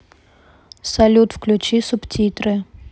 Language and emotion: Russian, neutral